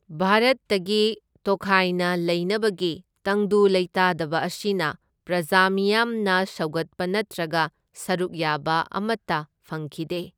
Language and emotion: Manipuri, neutral